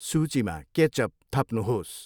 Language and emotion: Nepali, neutral